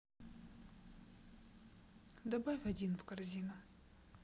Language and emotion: Russian, neutral